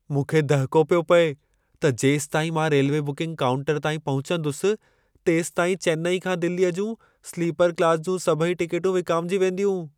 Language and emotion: Sindhi, fearful